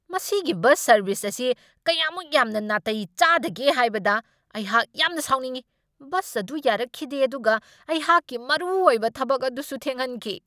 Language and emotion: Manipuri, angry